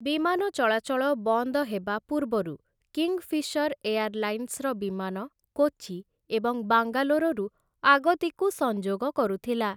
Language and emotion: Odia, neutral